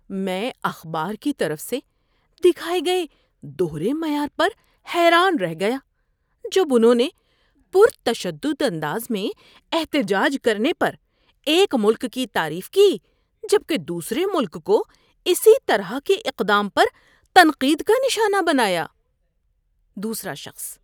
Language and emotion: Urdu, disgusted